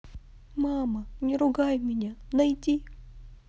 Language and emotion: Russian, sad